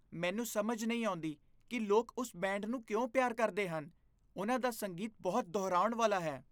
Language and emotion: Punjabi, disgusted